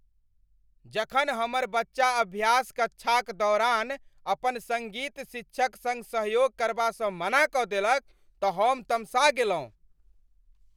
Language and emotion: Maithili, angry